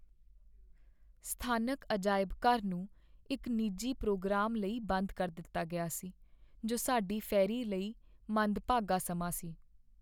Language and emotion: Punjabi, sad